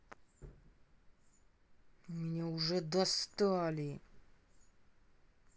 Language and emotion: Russian, angry